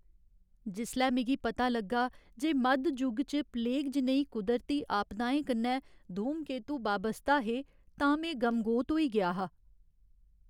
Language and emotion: Dogri, sad